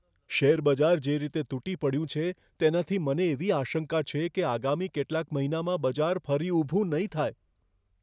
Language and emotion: Gujarati, fearful